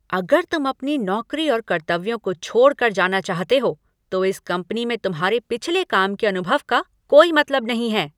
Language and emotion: Hindi, angry